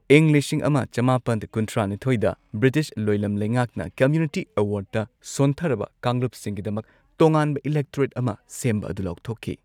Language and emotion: Manipuri, neutral